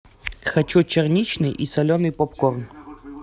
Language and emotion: Russian, neutral